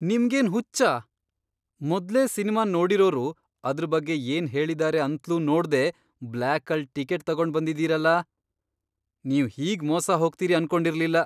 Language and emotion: Kannada, surprised